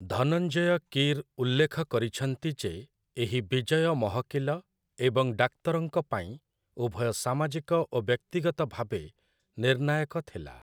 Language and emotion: Odia, neutral